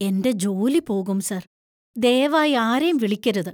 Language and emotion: Malayalam, fearful